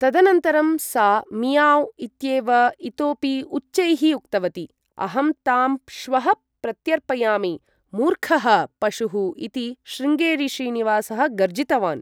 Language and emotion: Sanskrit, neutral